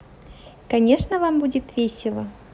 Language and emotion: Russian, positive